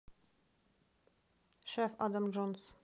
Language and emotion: Russian, neutral